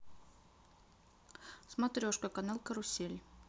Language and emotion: Russian, neutral